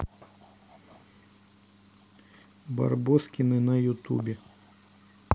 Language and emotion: Russian, neutral